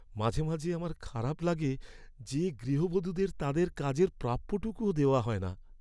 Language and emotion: Bengali, sad